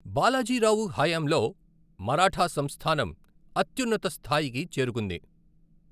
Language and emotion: Telugu, neutral